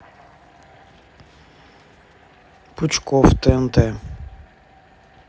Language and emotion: Russian, neutral